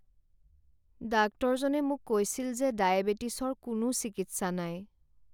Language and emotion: Assamese, sad